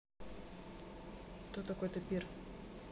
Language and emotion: Russian, neutral